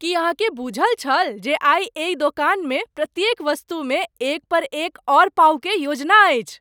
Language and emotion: Maithili, surprised